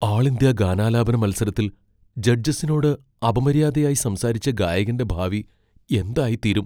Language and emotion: Malayalam, fearful